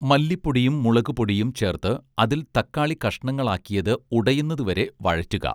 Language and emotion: Malayalam, neutral